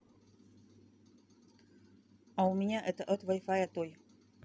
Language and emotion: Russian, neutral